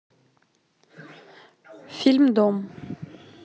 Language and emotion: Russian, neutral